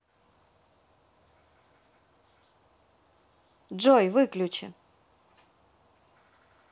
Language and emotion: Russian, neutral